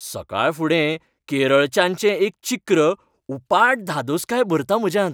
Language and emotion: Goan Konkani, happy